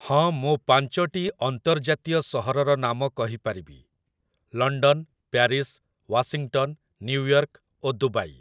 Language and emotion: Odia, neutral